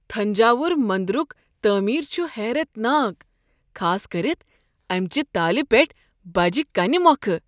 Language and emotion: Kashmiri, surprised